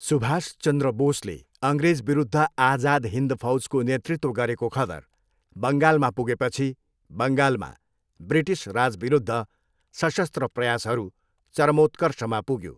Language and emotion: Nepali, neutral